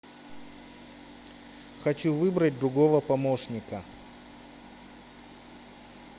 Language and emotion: Russian, neutral